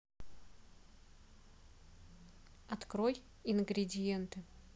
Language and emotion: Russian, neutral